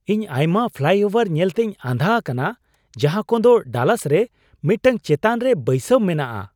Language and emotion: Santali, surprised